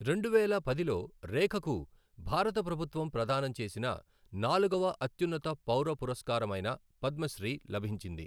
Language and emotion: Telugu, neutral